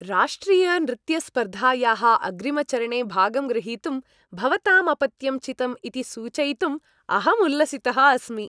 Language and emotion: Sanskrit, happy